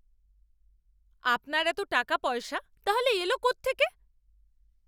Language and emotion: Bengali, angry